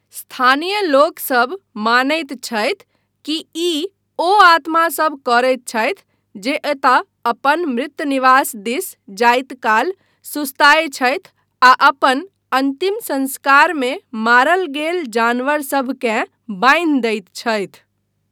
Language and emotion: Maithili, neutral